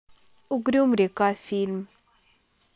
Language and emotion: Russian, neutral